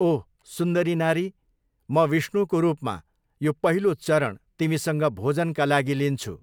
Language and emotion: Nepali, neutral